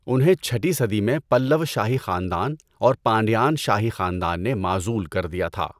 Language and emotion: Urdu, neutral